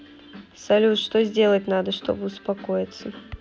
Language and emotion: Russian, neutral